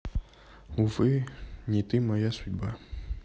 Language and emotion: Russian, sad